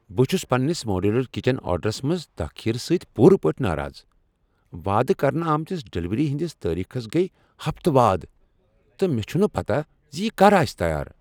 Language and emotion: Kashmiri, angry